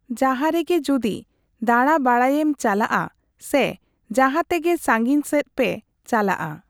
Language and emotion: Santali, neutral